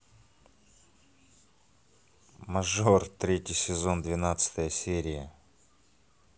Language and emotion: Russian, positive